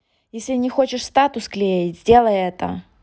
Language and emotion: Russian, angry